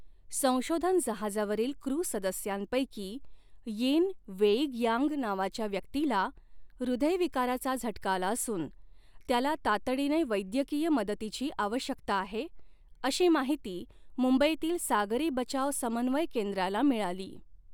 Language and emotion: Marathi, neutral